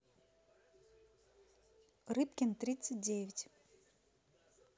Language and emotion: Russian, neutral